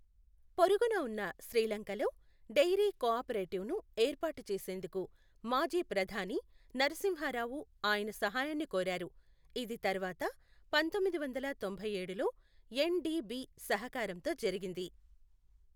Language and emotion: Telugu, neutral